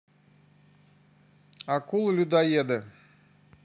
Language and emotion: Russian, neutral